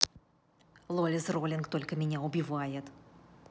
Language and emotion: Russian, angry